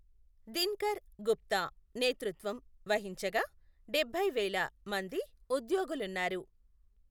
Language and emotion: Telugu, neutral